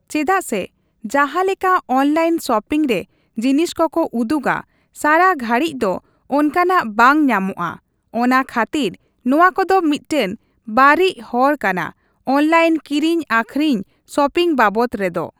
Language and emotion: Santali, neutral